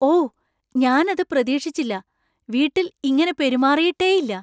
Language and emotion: Malayalam, surprised